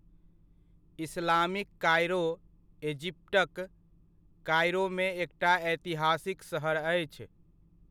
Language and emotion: Maithili, neutral